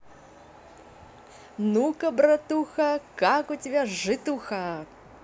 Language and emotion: Russian, positive